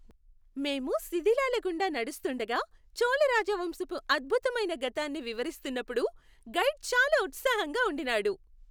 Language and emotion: Telugu, happy